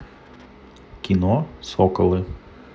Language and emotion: Russian, neutral